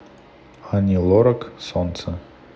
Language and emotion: Russian, neutral